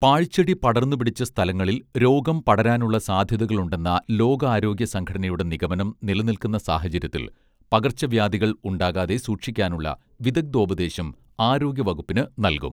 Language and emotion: Malayalam, neutral